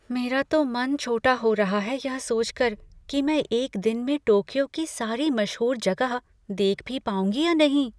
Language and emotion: Hindi, fearful